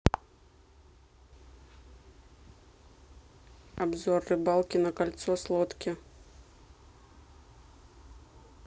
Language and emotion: Russian, neutral